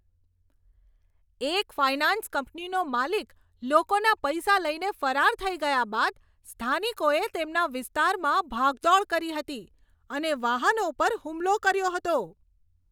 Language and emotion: Gujarati, angry